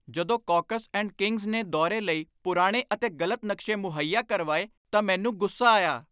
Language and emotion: Punjabi, angry